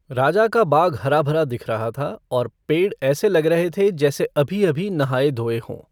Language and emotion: Hindi, neutral